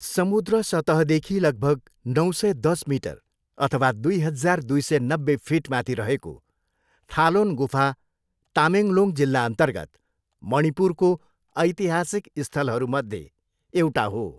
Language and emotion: Nepali, neutral